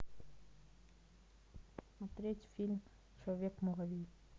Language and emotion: Russian, neutral